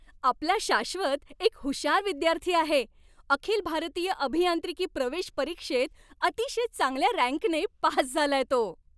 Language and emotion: Marathi, happy